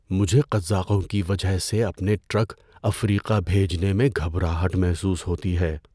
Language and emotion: Urdu, fearful